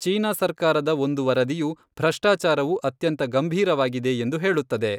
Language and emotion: Kannada, neutral